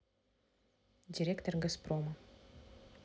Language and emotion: Russian, neutral